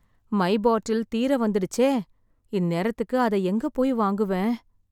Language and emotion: Tamil, sad